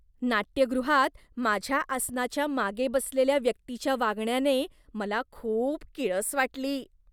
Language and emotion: Marathi, disgusted